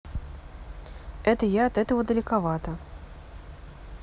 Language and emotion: Russian, neutral